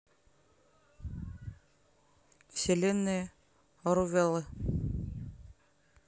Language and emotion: Russian, neutral